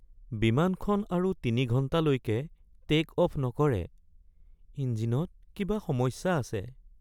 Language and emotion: Assamese, sad